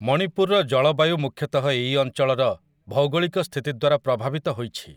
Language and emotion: Odia, neutral